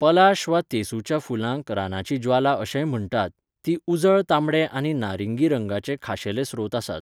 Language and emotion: Goan Konkani, neutral